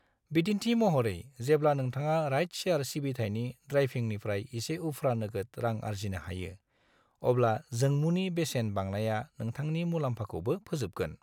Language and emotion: Bodo, neutral